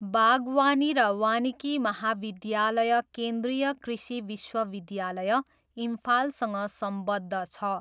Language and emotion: Nepali, neutral